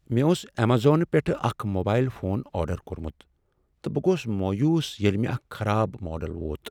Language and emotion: Kashmiri, sad